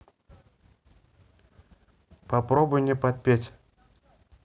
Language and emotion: Russian, neutral